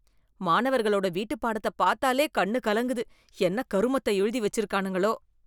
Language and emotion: Tamil, disgusted